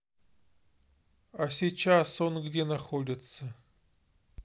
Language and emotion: Russian, neutral